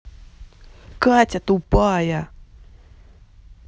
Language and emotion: Russian, angry